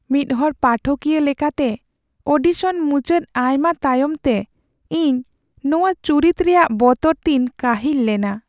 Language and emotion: Santali, sad